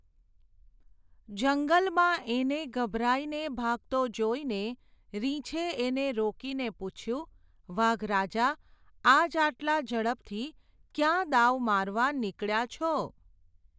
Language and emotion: Gujarati, neutral